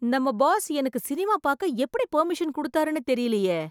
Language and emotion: Tamil, surprised